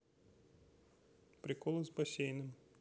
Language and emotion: Russian, neutral